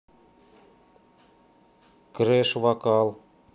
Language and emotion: Russian, neutral